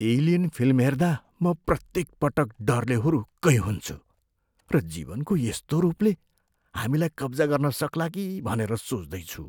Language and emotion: Nepali, fearful